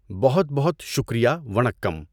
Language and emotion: Urdu, neutral